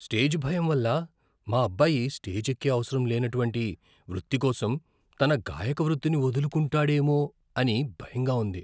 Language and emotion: Telugu, fearful